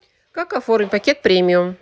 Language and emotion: Russian, neutral